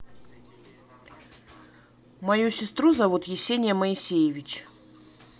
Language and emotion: Russian, neutral